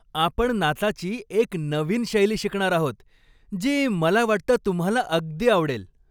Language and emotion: Marathi, happy